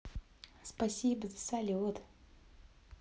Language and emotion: Russian, positive